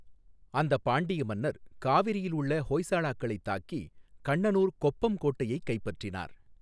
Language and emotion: Tamil, neutral